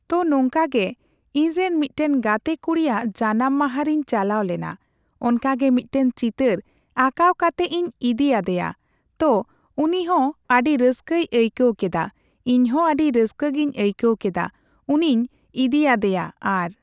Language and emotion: Santali, neutral